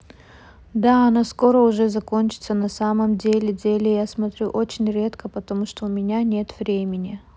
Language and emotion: Russian, neutral